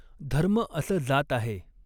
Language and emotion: Marathi, neutral